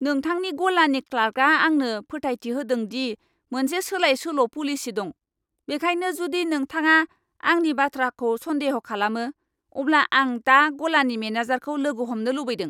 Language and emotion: Bodo, angry